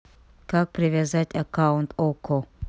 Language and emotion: Russian, neutral